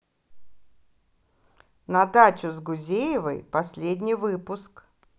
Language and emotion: Russian, positive